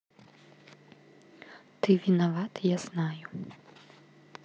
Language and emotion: Russian, neutral